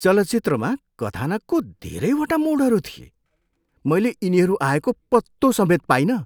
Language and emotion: Nepali, surprised